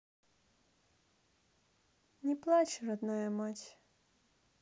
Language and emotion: Russian, sad